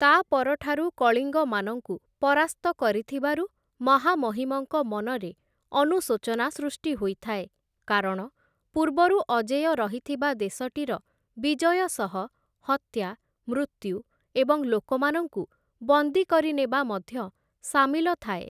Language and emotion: Odia, neutral